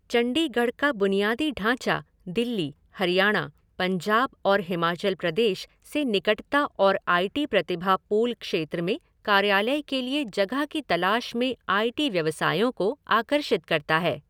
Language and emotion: Hindi, neutral